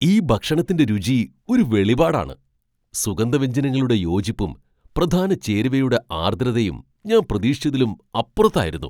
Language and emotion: Malayalam, surprised